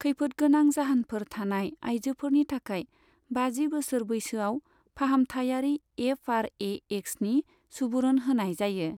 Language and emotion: Bodo, neutral